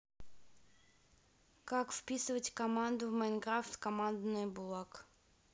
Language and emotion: Russian, neutral